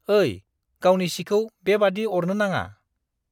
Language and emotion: Bodo, disgusted